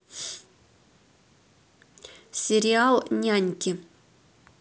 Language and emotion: Russian, neutral